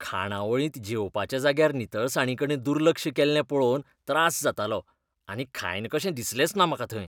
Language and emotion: Goan Konkani, disgusted